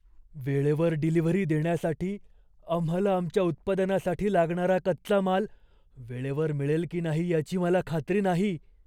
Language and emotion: Marathi, fearful